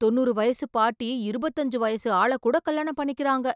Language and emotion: Tamil, surprised